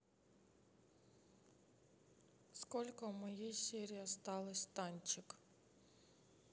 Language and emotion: Russian, neutral